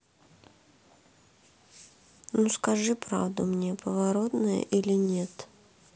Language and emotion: Russian, sad